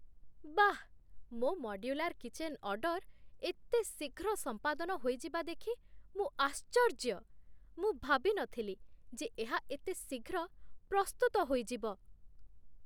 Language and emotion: Odia, surprised